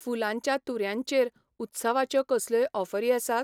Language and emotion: Goan Konkani, neutral